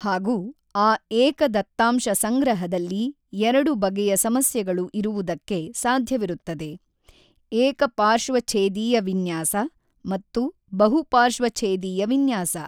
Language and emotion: Kannada, neutral